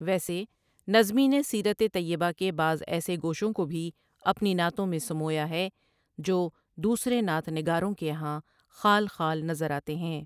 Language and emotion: Urdu, neutral